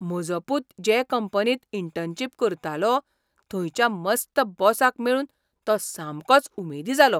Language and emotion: Goan Konkani, surprised